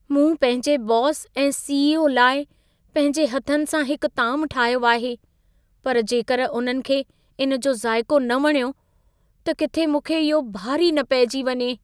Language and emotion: Sindhi, fearful